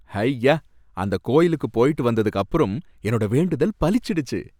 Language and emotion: Tamil, happy